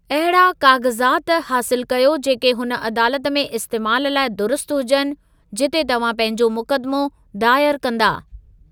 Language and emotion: Sindhi, neutral